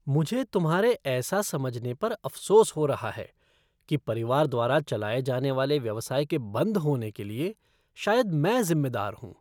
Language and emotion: Hindi, disgusted